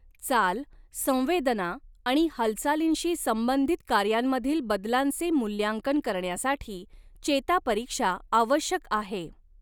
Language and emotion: Marathi, neutral